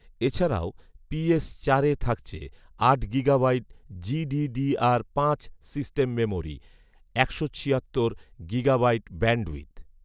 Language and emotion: Bengali, neutral